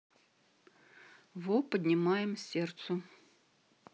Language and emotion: Russian, neutral